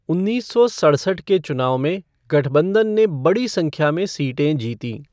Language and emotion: Hindi, neutral